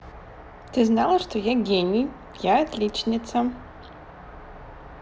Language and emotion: Russian, positive